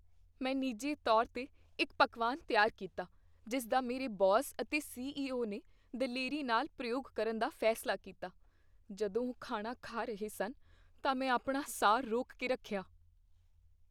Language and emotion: Punjabi, fearful